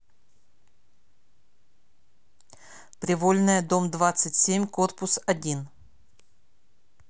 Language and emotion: Russian, neutral